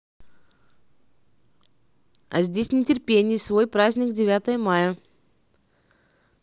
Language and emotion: Russian, neutral